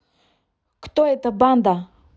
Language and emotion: Russian, neutral